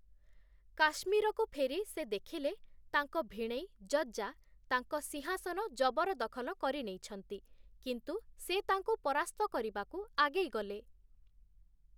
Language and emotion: Odia, neutral